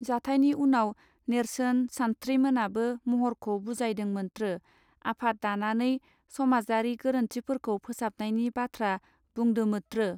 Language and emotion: Bodo, neutral